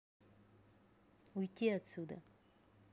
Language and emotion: Russian, angry